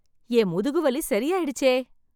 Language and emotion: Tamil, happy